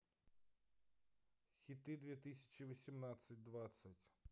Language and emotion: Russian, neutral